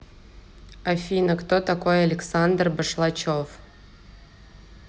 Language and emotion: Russian, neutral